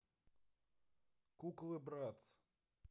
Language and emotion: Russian, neutral